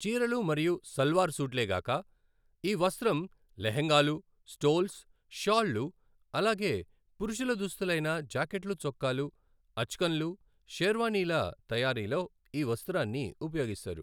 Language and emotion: Telugu, neutral